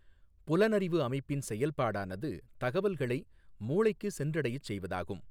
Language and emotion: Tamil, neutral